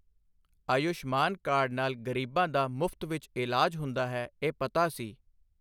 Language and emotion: Punjabi, neutral